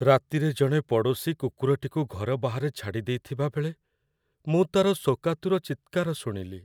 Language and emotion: Odia, sad